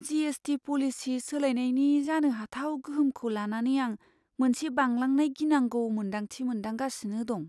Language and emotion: Bodo, fearful